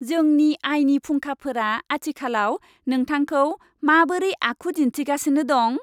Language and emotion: Bodo, happy